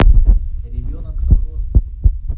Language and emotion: Russian, neutral